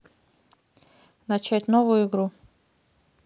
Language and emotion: Russian, neutral